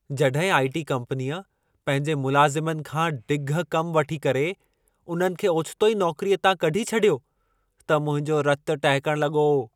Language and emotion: Sindhi, angry